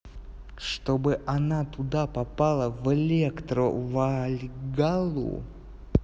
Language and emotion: Russian, neutral